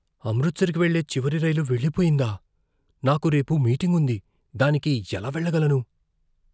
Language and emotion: Telugu, fearful